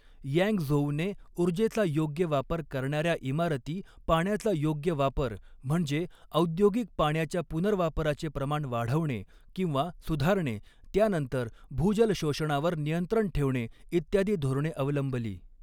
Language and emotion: Marathi, neutral